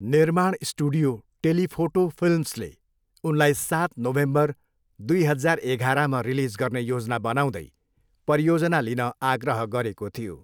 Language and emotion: Nepali, neutral